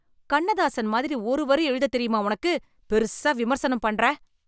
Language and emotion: Tamil, angry